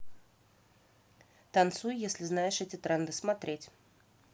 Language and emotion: Russian, neutral